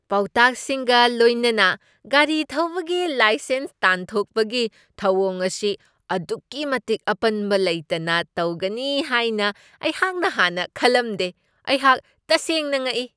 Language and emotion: Manipuri, surprised